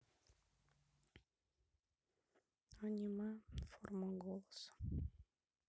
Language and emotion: Russian, sad